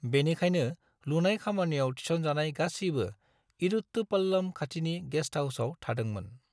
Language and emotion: Bodo, neutral